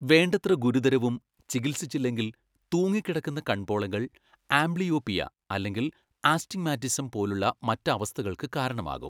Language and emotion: Malayalam, neutral